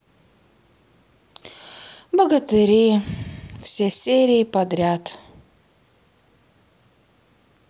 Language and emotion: Russian, sad